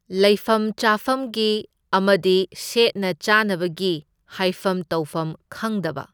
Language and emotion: Manipuri, neutral